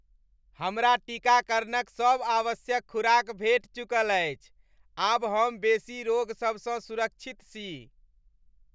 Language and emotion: Maithili, happy